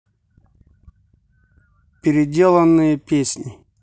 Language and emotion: Russian, neutral